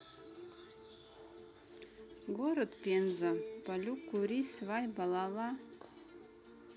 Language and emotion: Russian, neutral